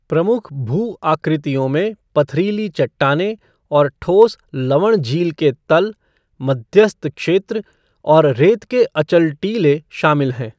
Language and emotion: Hindi, neutral